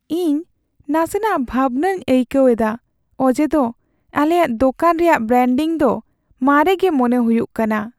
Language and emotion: Santali, sad